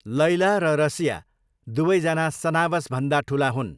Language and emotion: Nepali, neutral